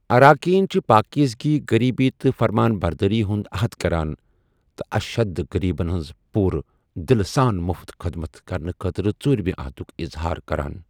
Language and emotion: Kashmiri, neutral